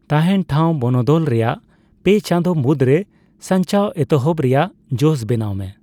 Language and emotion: Santali, neutral